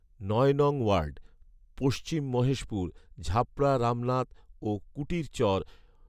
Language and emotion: Bengali, neutral